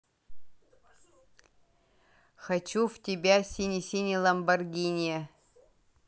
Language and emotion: Russian, neutral